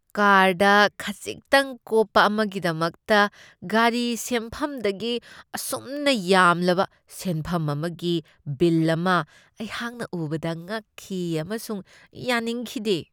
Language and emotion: Manipuri, disgusted